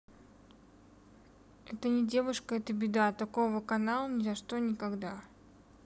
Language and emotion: Russian, neutral